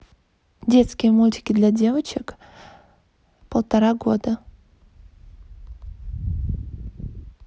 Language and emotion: Russian, neutral